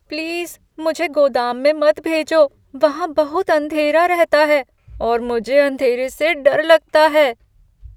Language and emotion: Hindi, fearful